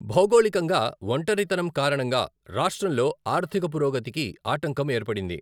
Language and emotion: Telugu, neutral